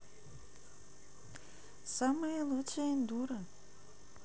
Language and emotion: Russian, neutral